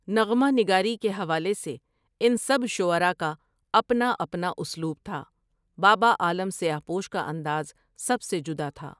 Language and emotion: Urdu, neutral